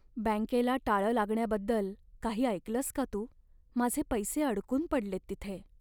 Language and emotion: Marathi, sad